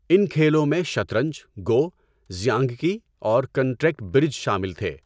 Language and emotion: Urdu, neutral